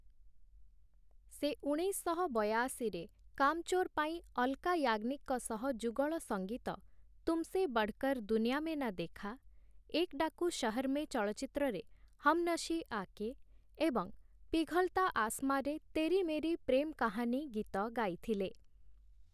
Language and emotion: Odia, neutral